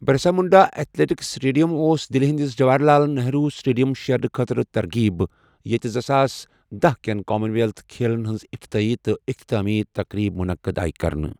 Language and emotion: Kashmiri, neutral